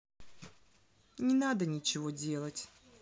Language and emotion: Russian, sad